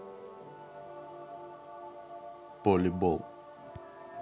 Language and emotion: Russian, neutral